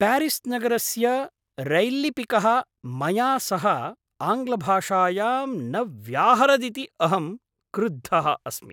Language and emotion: Sanskrit, angry